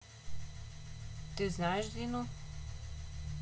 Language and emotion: Russian, neutral